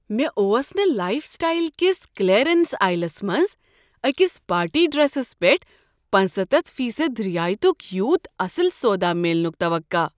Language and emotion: Kashmiri, surprised